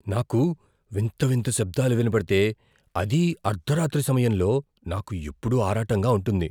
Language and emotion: Telugu, fearful